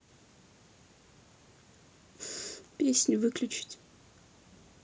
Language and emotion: Russian, sad